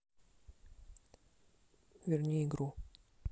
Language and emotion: Russian, neutral